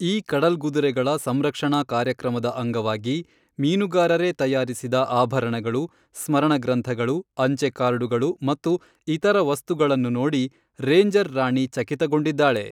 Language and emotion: Kannada, neutral